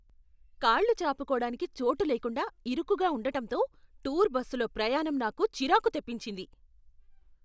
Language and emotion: Telugu, angry